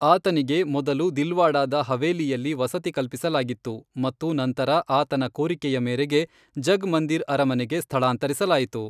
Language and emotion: Kannada, neutral